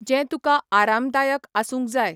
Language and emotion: Goan Konkani, neutral